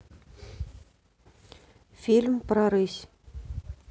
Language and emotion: Russian, neutral